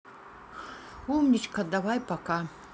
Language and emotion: Russian, neutral